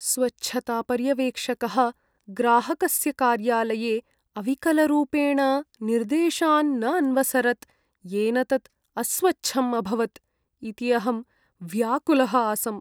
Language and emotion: Sanskrit, sad